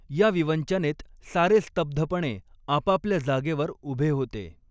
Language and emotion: Marathi, neutral